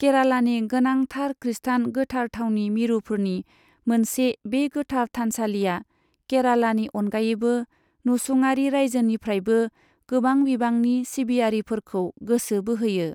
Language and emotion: Bodo, neutral